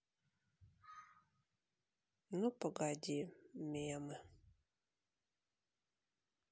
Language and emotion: Russian, sad